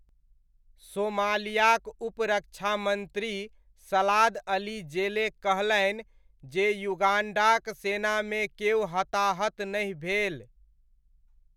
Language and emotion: Maithili, neutral